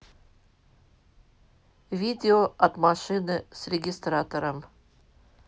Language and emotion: Russian, neutral